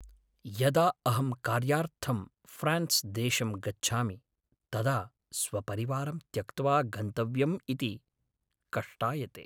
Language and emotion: Sanskrit, sad